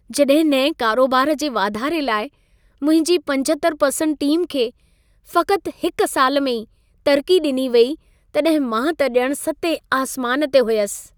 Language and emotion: Sindhi, happy